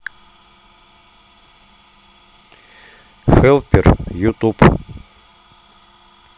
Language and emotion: Russian, neutral